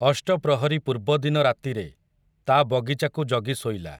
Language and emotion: Odia, neutral